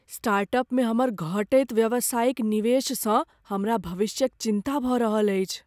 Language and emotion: Maithili, fearful